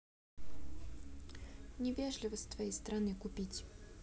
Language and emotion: Russian, neutral